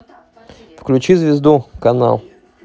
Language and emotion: Russian, neutral